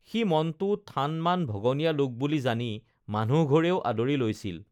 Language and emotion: Assamese, neutral